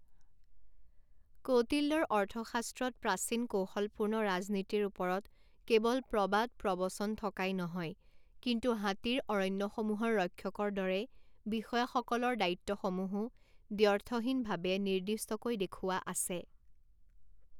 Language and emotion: Assamese, neutral